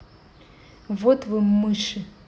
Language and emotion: Russian, angry